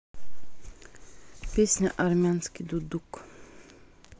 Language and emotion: Russian, neutral